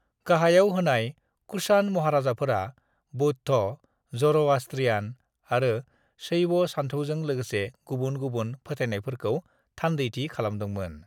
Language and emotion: Bodo, neutral